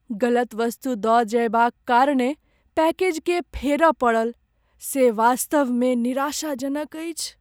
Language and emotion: Maithili, sad